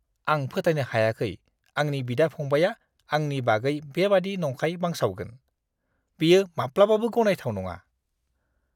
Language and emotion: Bodo, disgusted